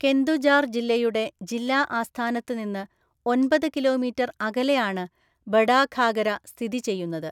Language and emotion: Malayalam, neutral